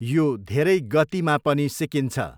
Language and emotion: Nepali, neutral